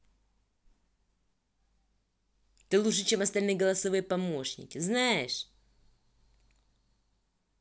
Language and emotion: Russian, angry